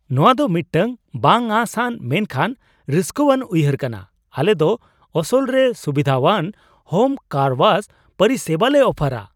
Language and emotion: Santali, surprised